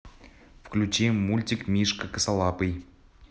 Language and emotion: Russian, neutral